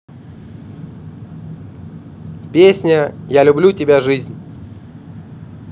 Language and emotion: Russian, neutral